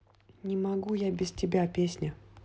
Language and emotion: Russian, neutral